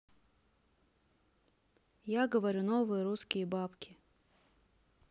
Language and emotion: Russian, neutral